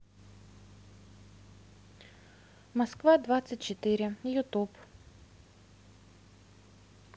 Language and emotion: Russian, neutral